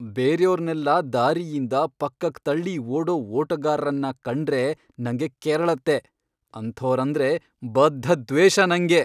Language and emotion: Kannada, angry